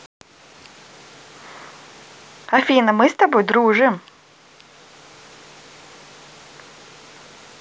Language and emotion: Russian, positive